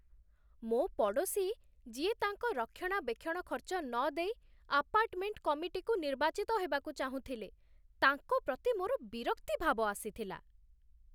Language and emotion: Odia, disgusted